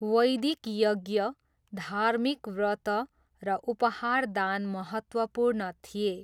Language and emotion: Nepali, neutral